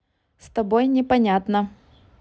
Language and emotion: Russian, neutral